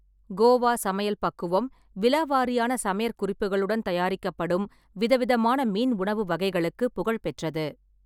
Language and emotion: Tamil, neutral